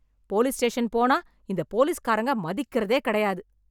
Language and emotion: Tamil, angry